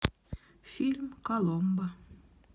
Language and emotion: Russian, neutral